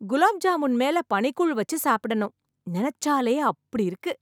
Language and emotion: Tamil, happy